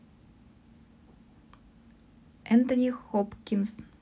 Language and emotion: Russian, neutral